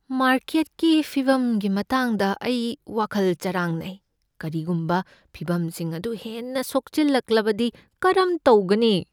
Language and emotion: Manipuri, fearful